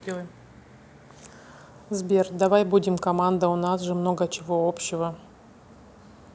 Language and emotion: Russian, neutral